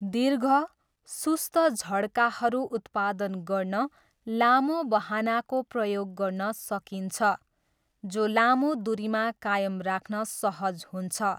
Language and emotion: Nepali, neutral